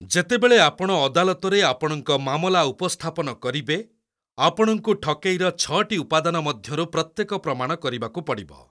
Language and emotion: Odia, neutral